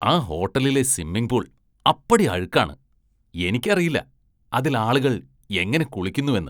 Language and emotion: Malayalam, disgusted